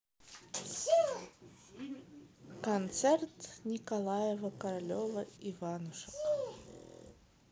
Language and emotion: Russian, neutral